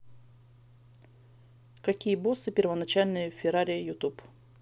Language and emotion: Russian, neutral